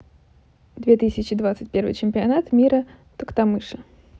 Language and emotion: Russian, neutral